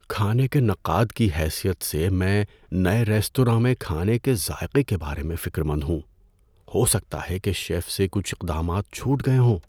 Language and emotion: Urdu, fearful